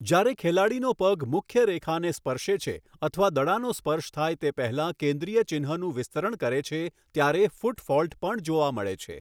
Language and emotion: Gujarati, neutral